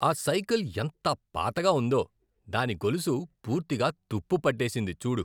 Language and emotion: Telugu, disgusted